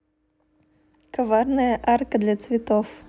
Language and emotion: Russian, neutral